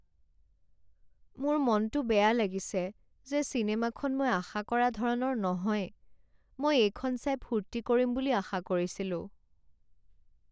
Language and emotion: Assamese, sad